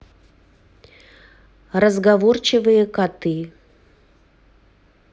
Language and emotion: Russian, neutral